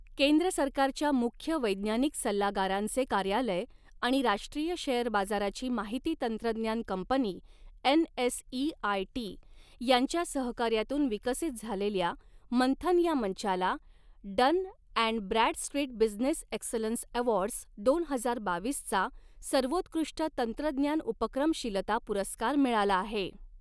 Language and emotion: Marathi, neutral